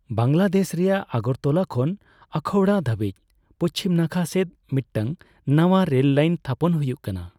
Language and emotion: Santali, neutral